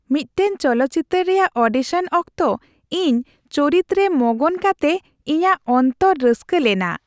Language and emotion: Santali, happy